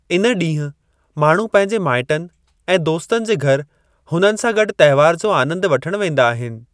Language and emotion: Sindhi, neutral